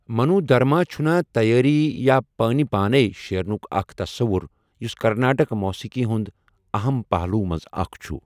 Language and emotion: Kashmiri, neutral